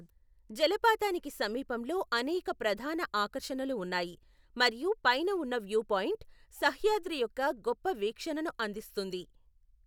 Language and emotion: Telugu, neutral